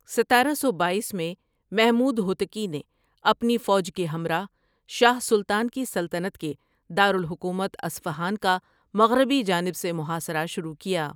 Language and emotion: Urdu, neutral